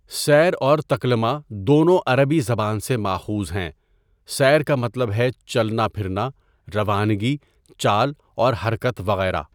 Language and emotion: Urdu, neutral